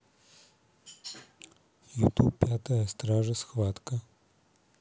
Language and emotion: Russian, neutral